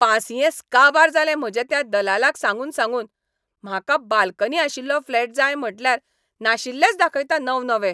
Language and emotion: Goan Konkani, angry